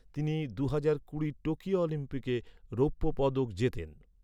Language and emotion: Bengali, neutral